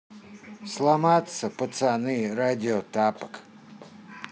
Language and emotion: Russian, neutral